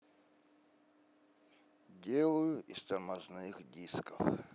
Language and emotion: Russian, sad